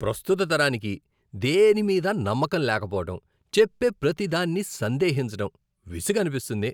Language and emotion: Telugu, disgusted